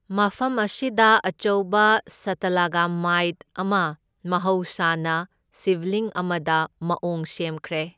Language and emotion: Manipuri, neutral